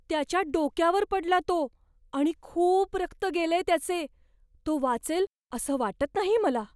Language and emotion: Marathi, fearful